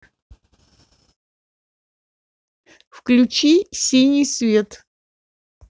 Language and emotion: Russian, neutral